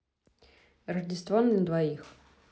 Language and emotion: Russian, neutral